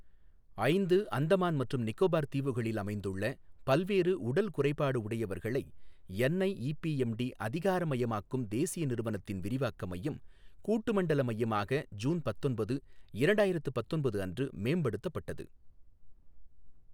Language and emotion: Tamil, neutral